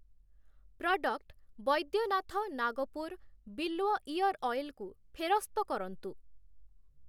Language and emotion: Odia, neutral